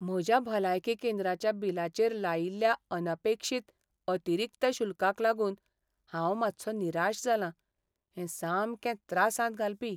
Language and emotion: Goan Konkani, sad